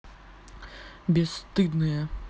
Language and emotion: Russian, angry